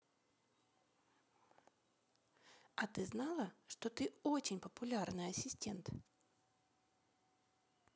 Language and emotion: Russian, positive